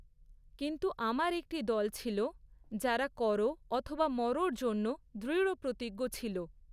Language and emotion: Bengali, neutral